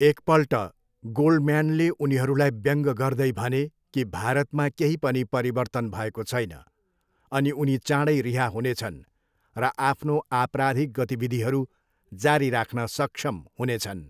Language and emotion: Nepali, neutral